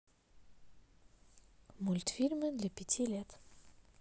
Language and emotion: Russian, neutral